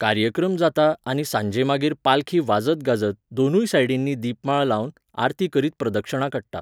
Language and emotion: Goan Konkani, neutral